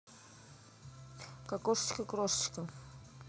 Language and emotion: Russian, neutral